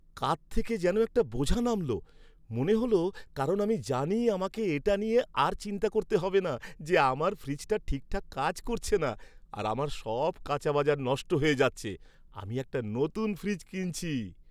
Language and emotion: Bengali, happy